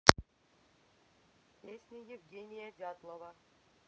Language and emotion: Russian, neutral